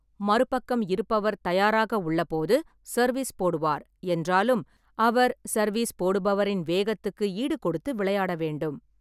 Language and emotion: Tamil, neutral